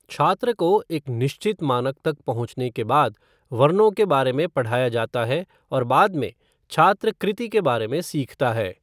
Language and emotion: Hindi, neutral